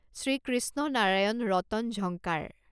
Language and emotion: Assamese, neutral